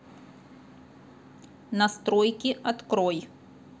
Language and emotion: Russian, neutral